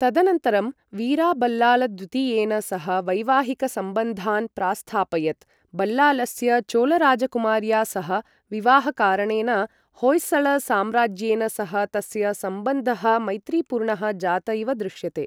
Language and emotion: Sanskrit, neutral